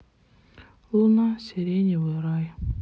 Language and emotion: Russian, sad